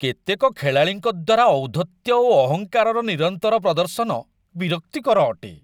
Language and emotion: Odia, disgusted